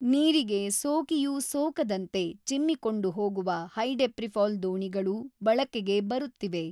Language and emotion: Kannada, neutral